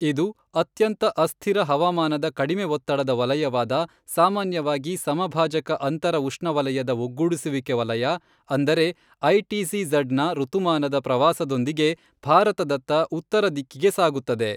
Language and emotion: Kannada, neutral